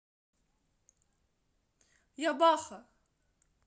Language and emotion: Russian, positive